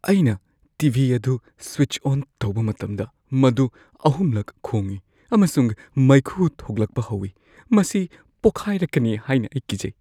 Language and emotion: Manipuri, fearful